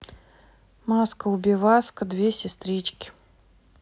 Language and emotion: Russian, neutral